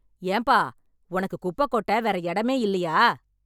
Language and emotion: Tamil, angry